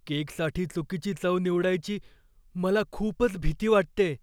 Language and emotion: Marathi, fearful